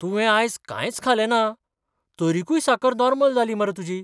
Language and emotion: Goan Konkani, surprised